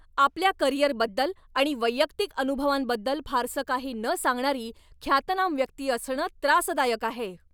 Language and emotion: Marathi, angry